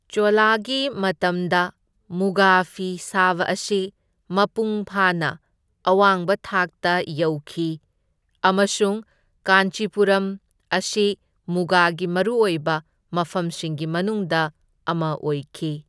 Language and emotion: Manipuri, neutral